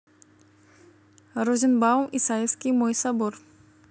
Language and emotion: Russian, neutral